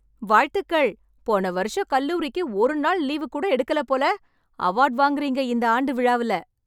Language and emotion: Tamil, happy